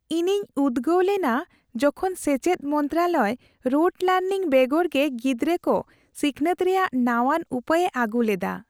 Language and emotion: Santali, happy